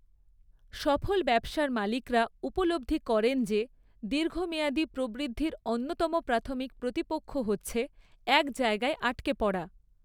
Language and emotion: Bengali, neutral